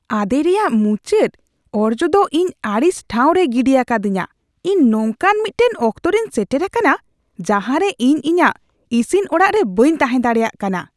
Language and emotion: Santali, disgusted